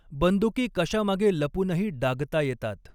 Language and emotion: Marathi, neutral